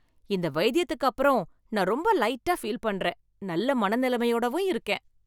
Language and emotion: Tamil, happy